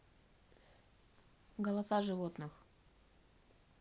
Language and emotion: Russian, neutral